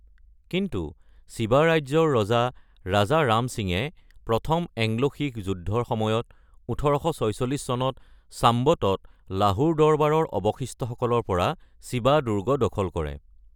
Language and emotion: Assamese, neutral